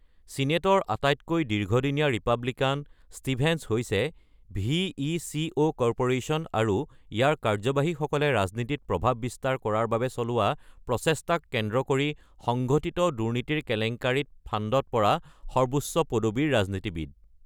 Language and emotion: Assamese, neutral